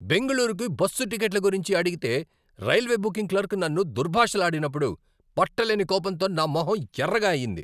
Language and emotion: Telugu, angry